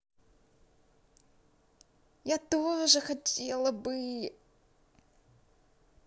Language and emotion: Russian, positive